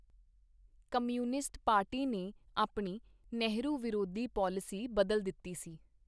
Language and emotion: Punjabi, neutral